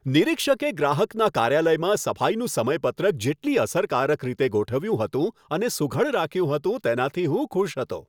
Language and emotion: Gujarati, happy